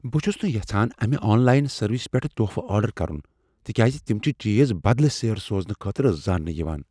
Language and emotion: Kashmiri, fearful